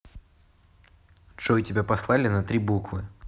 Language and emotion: Russian, neutral